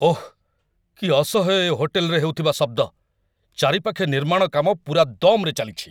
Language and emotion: Odia, angry